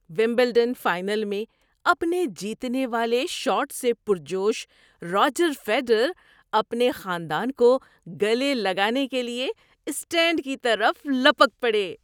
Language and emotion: Urdu, happy